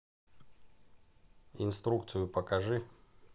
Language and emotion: Russian, neutral